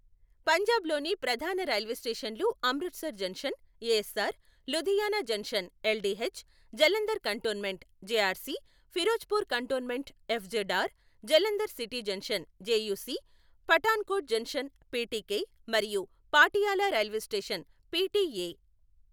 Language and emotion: Telugu, neutral